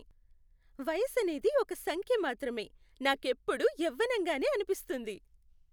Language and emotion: Telugu, happy